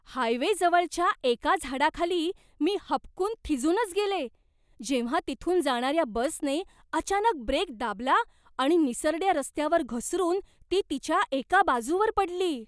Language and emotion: Marathi, surprised